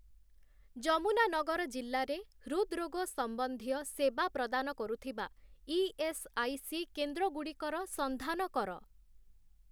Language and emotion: Odia, neutral